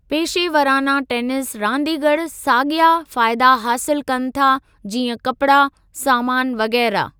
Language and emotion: Sindhi, neutral